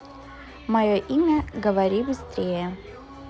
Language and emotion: Russian, neutral